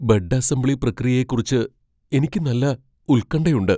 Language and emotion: Malayalam, fearful